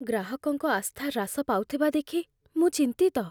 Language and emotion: Odia, fearful